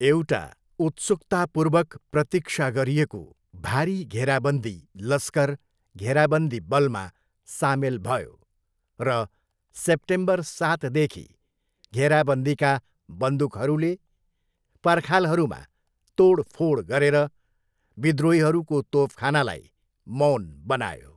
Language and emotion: Nepali, neutral